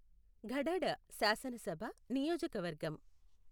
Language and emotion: Telugu, neutral